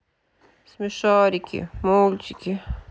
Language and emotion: Russian, sad